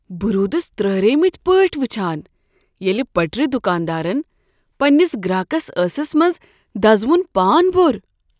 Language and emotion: Kashmiri, surprised